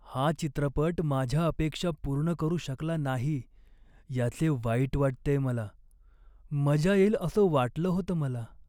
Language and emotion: Marathi, sad